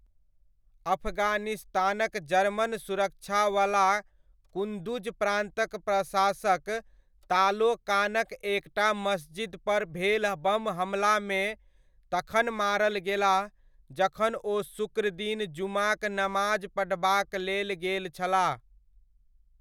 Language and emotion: Maithili, neutral